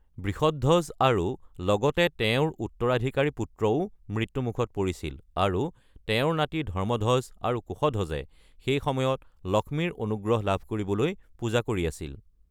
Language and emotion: Assamese, neutral